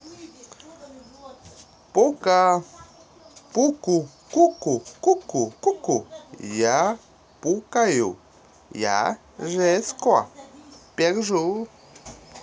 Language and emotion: Russian, positive